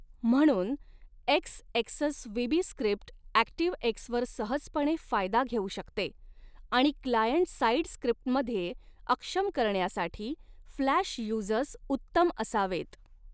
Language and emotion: Marathi, neutral